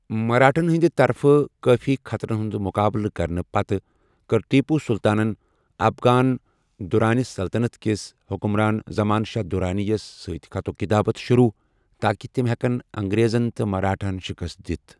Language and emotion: Kashmiri, neutral